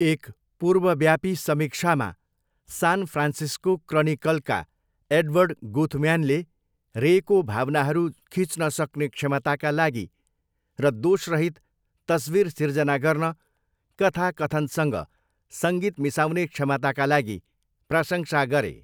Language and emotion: Nepali, neutral